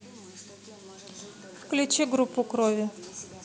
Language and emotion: Russian, neutral